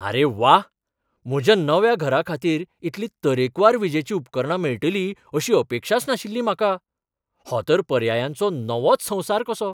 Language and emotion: Goan Konkani, surprised